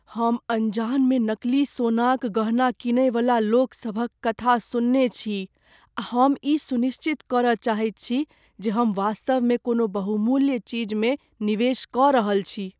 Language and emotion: Maithili, fearful